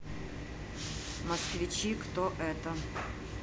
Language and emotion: Russian, neutral